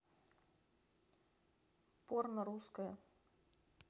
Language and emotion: Russian, neutral